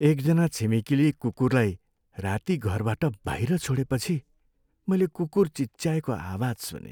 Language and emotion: Nepali, sad